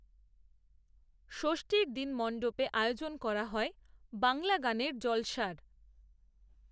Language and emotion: Bengali, neutral